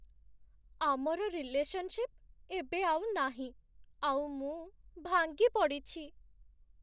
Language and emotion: Odia, sad